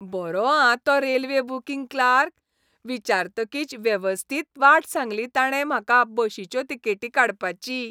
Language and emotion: Goan Konkani, happy